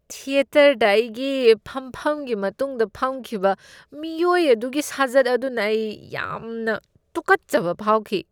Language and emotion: Manipuri, disgusted